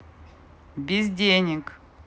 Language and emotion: Russian, neutral